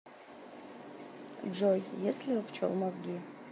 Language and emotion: Russian, neutral